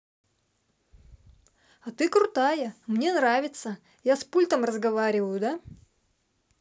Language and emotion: Russian, positive